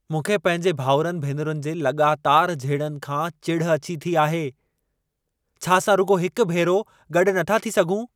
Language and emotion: Sindhi, angry